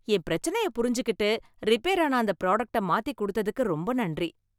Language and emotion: Tamil, happy